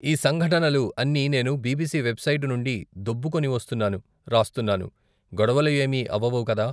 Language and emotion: Telugu, neutral